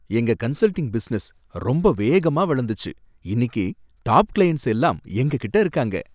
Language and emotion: Tamil, happy